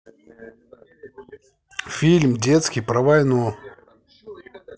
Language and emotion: Russian, neutral